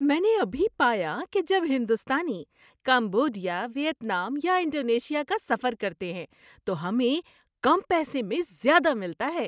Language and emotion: Urdu, happy